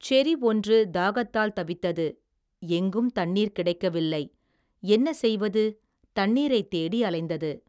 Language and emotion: Tamil, neutral